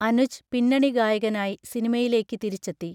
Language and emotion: Malayalam, neutral